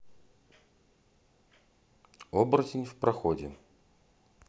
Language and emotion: Russian, neutral